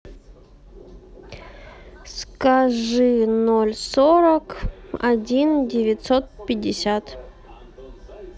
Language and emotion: Russian, neutral